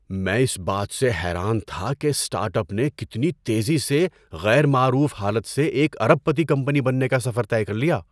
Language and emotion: Urdu, surprised